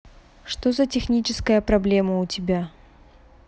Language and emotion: Russian, neutral